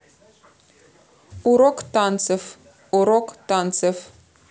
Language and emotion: Russian, neutral